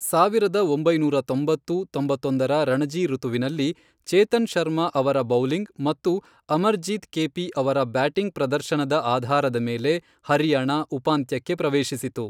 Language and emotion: Kannada, neutral